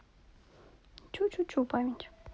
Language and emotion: Russian, neutral